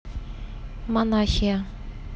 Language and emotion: Russian, neutral